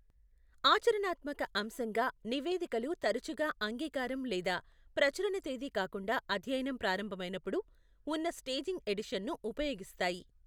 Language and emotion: Telugu, neutral